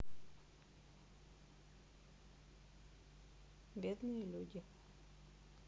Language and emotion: Russian, neutral